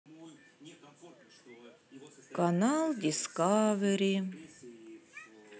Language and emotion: Russian, sad